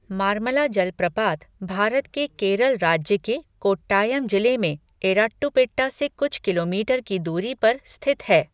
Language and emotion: Hindi, neutral